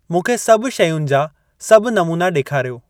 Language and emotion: Sindhi, neutral